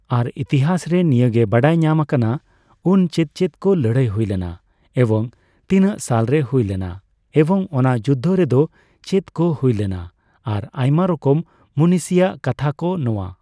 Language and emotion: Santali, neutral